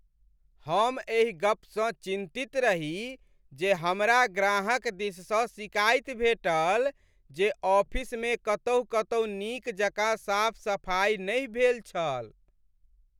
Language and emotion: Maithili, sad